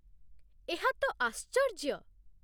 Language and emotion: Odia, surprised